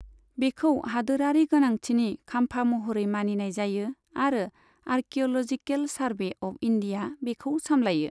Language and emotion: Bodo, neutral